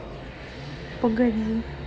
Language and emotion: Russian, neutral